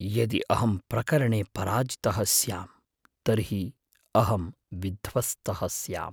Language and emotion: Sanskrit, fearful